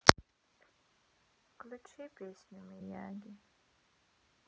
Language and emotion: Russian, sad